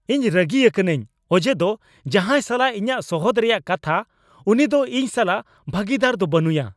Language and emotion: Santali, angry